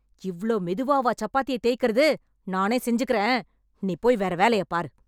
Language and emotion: Tamil, angry